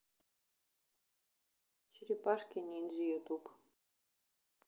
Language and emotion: Russian, neutral